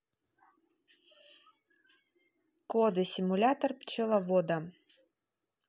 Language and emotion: Russian, neutral